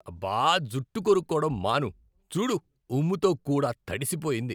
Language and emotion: Telugu, disgusted